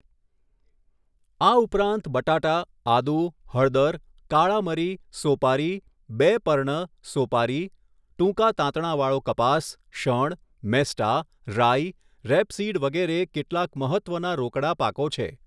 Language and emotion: Gujarati, neutral